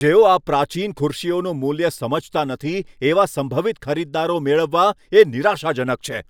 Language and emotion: Gujarati, angry